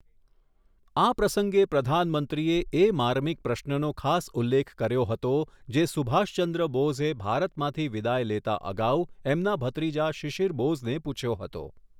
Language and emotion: Gujarati, neutral